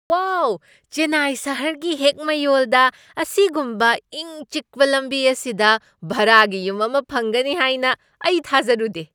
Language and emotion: Manipuri, surprised